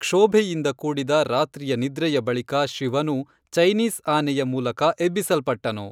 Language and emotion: Kannada, neutral